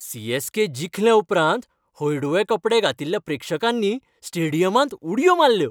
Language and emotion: Goan Konkani, happy